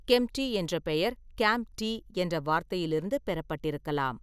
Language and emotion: Tamil, neutral